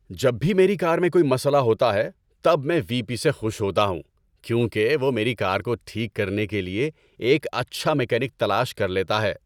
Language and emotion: Urdu, happy